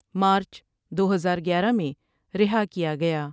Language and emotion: Urdu, neutral